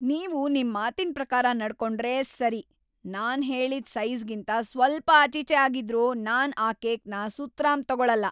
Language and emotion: Kannada, angry